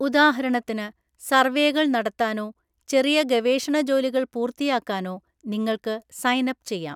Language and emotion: Malayalam, neutral